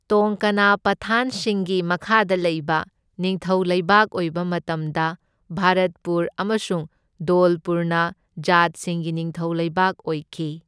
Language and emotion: Manipuri, neutral